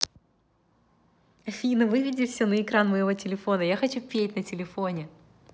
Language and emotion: Russian, positive